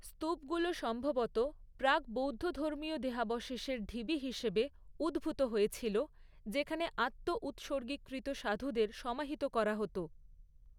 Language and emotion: Bengali, neutral